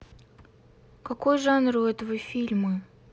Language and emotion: Russian, angry